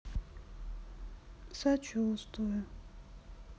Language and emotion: Russian, sad